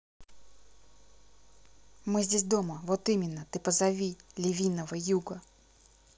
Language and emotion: Russian, neutral